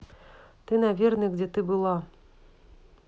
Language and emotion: Russian, neutral